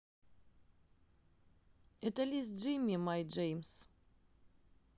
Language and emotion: Russian, neutral